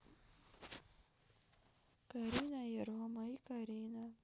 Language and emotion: Russian, neutral